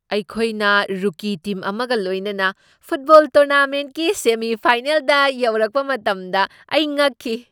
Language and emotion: Manipuri, surprised